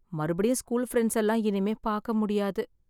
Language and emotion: Tamil, sad